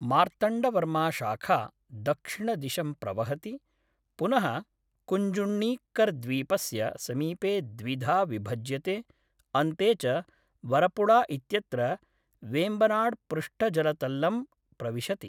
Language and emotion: Sanskrit, neutral